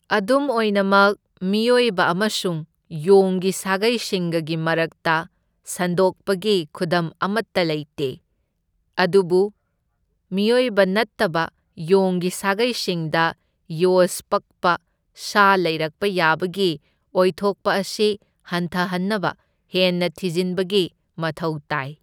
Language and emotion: Manipuri, neutral